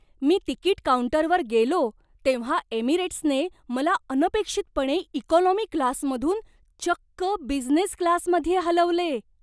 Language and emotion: Marathi, surprised